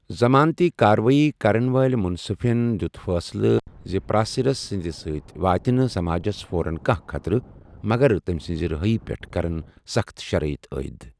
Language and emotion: Kashmiri, neutral